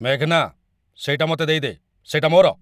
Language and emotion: Odia, angry